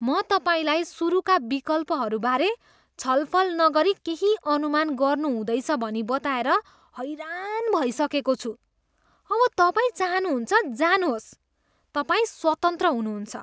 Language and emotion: Nepali, disgusted